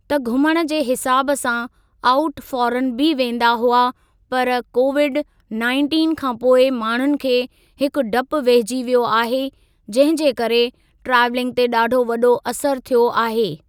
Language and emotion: Sindhi, neutral